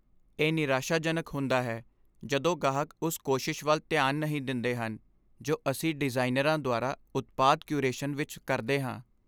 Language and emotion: Punjabi, sad